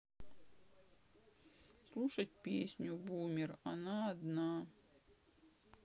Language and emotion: Russian, sad